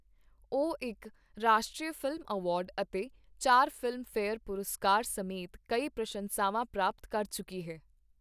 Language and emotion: Punjabi, neutral